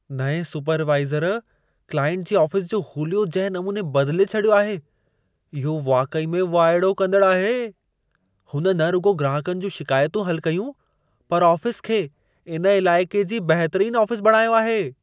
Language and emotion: Sindhi, surprised